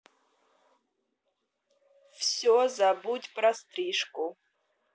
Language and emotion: Russian, neutral